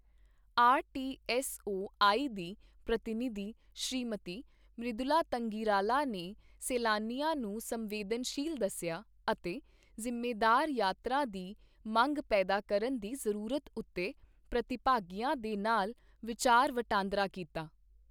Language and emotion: Punjabi, neutral